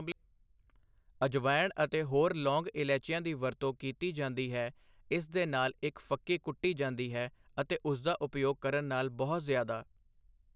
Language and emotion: Punjabi, neutral